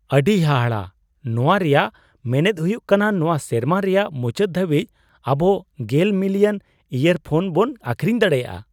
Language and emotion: Santali, surprised